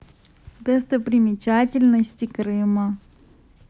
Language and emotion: Russian, positive